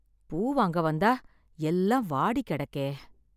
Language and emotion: Tamil, sad